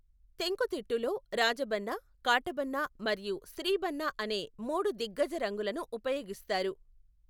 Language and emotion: Telugu, neutral